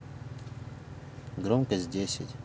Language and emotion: Russian, neutral